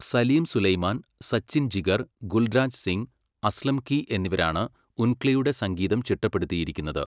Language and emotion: Malayalam, neutral